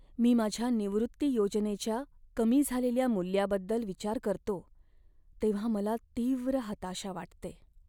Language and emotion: Marathi, sad